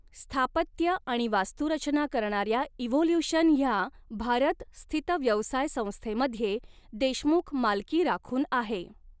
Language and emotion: Marathi, neutral